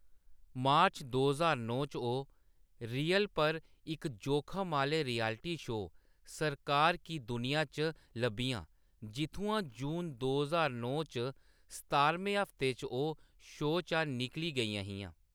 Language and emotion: Dogri, neutral